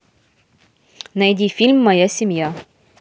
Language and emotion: Russian, neutral